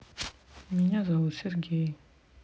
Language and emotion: Russian, neutral